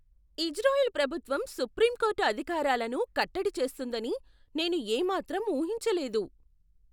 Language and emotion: Telugu, surprised